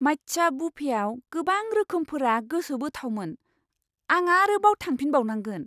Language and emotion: Bodo, surprised